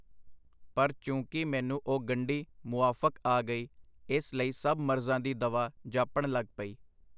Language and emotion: Punjabi, neutral